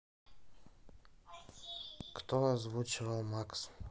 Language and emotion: Russian, neutral